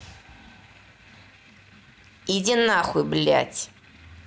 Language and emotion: Russian, angry